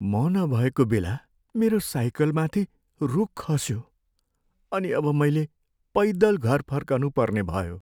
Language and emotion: Nepali, sad